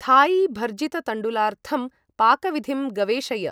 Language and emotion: Sanskrit, neutral